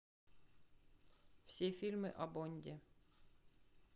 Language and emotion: Russian, neutral